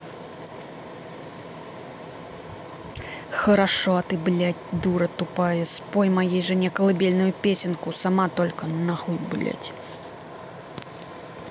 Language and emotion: Russian, angry